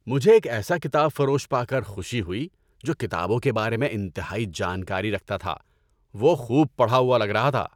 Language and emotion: Urdu, happy